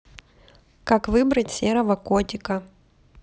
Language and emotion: Russian, neutral